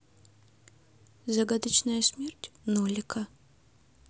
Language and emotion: Russian, neutral